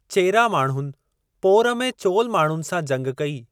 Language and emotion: Sindhi, neutral